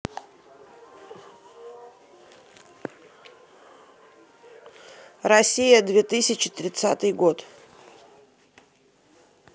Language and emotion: Russian, neutral